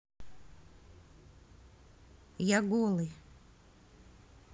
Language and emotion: Russian, neutral